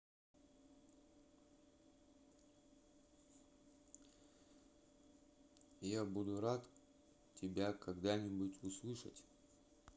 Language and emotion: Russian, neutral